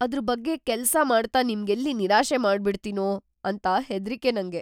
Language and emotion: Kannada, fearful